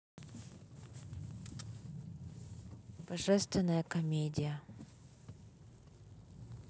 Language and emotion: Russian, neutral